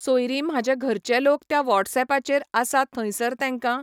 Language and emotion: Goan Konkani, neutral